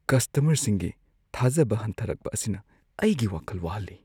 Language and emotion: Manipuri, fearful